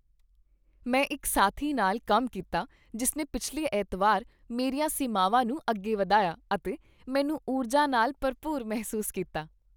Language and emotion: Punjabi, happy